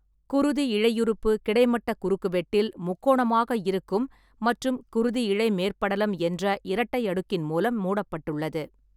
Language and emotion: Tamil, neutral